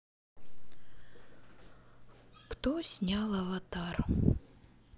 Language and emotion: Russian, sad